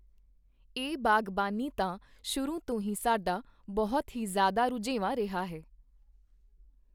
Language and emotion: Punjabi, neutral